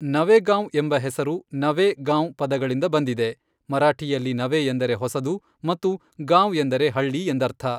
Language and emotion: Kannada, neutral